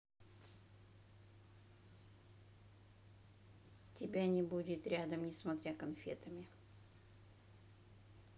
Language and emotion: Russian, neutral